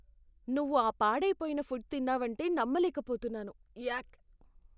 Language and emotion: Telugu, disgusted